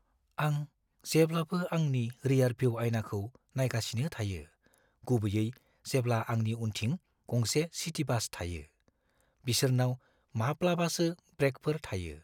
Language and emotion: Bodo, fearful